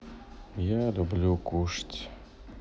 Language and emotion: Russian, sad